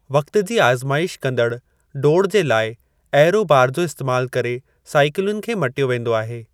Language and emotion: Sindhi, neutral